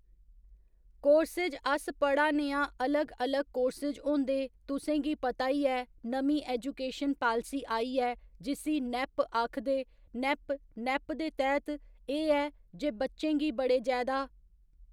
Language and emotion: Dogri, neutral